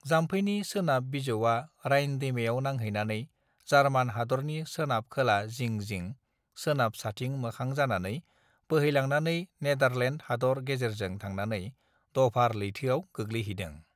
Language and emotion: Bodo, neutral